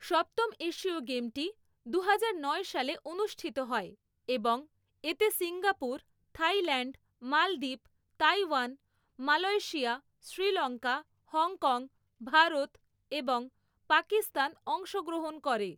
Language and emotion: Bengali, neutral